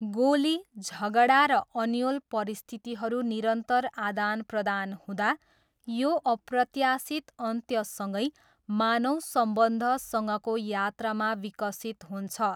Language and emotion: Nepali, neutral